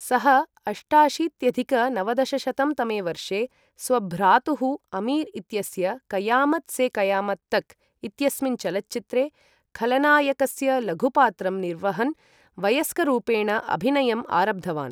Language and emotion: Sanskrit, neutral